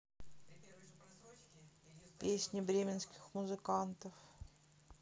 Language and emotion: Russian, sad